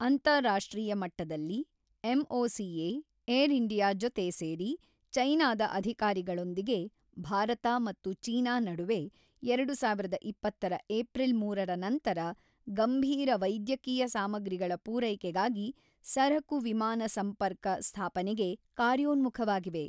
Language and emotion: Kannada, neutral